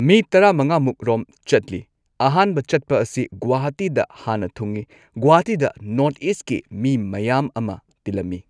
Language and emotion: Manipuri, neutral